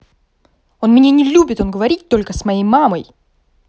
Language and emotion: Russian, angry